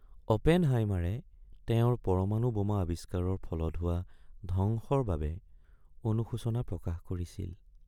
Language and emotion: Assamese, sad